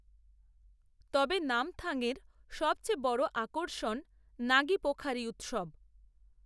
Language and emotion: Bengali, neutral